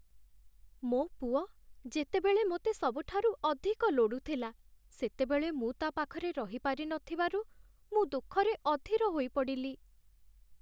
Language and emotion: Odia, sad